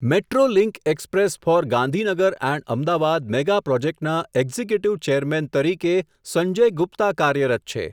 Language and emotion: Gujarati, neutral